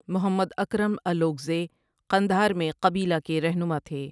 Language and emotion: Urdu, neutral